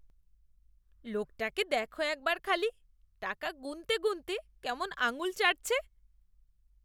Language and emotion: Bengali, disgusted